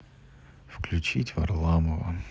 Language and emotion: Russian, neutral